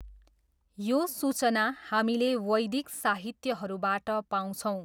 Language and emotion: Nepali, neutral